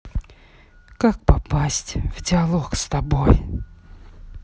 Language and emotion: Russian, sad